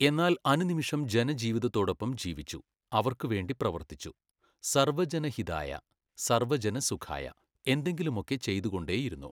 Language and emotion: Malayalam, neutral